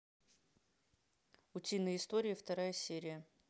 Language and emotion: Russian, neutral